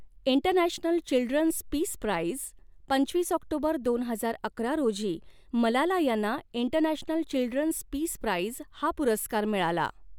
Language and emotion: Marathi, neutral